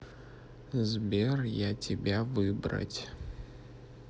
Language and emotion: Russian, sad